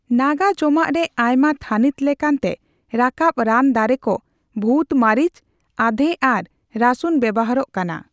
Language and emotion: Santali, neutral